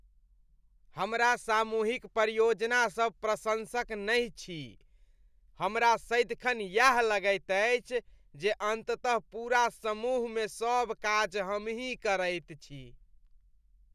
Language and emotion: Maithili, disgusted